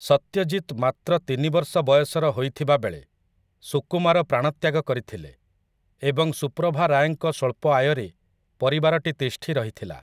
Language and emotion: Odia, neutral